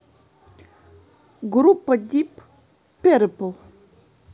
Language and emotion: Russian, neutral